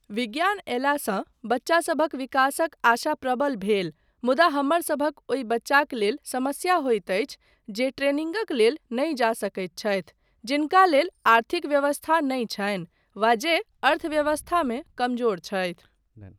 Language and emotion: Maithili, neutral